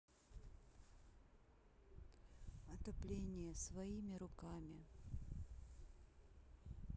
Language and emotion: Russian, neutral